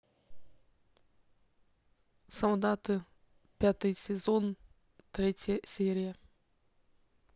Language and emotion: Russian, neutral